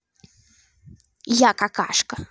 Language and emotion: Russian, angry